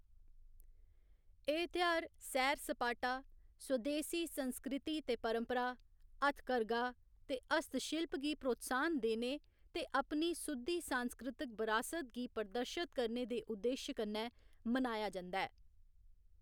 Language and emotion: Dogri, neutral